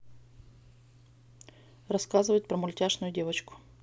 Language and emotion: Russian, neutral